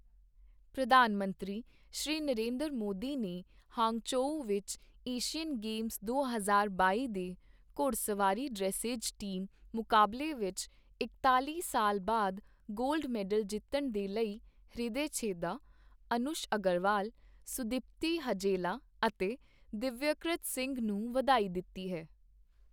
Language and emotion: Punjabi, neutral